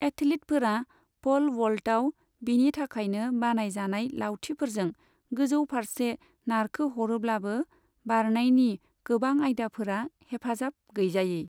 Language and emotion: Bodo, neutral